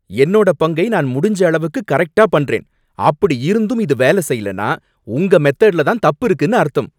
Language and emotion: Tamil, angry